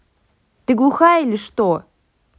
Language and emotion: Russian, angry